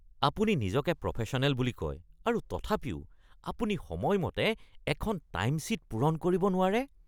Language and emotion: Assamese, disgusted